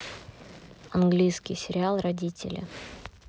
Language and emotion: Russian, neutral